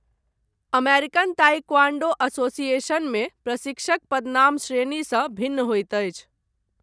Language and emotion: Maithili, neutral